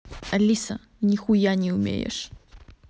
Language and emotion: Russian, neutral